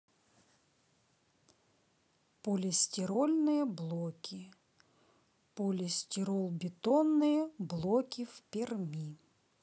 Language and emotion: Russian, neutral